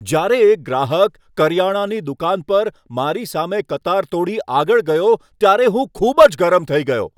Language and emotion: Gujarati, angry